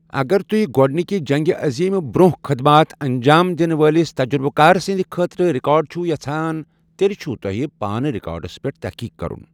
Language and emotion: Kashmiri, neutral